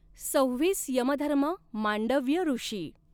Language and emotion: Marathi, neutral